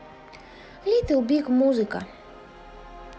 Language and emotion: Russian, neutral